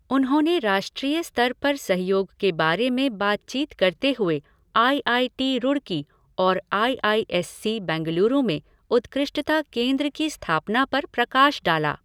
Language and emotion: Hindi, neutral